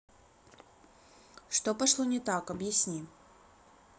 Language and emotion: Russian, neutral